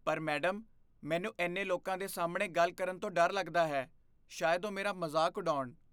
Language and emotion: Punjabi, fearful